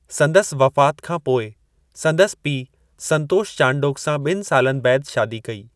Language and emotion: Sindhi, neutral